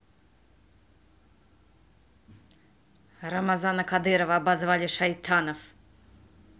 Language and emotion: Russian, angry